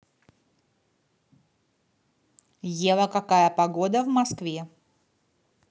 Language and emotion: Russian, neutral